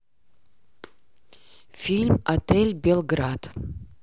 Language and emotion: Russian, neutral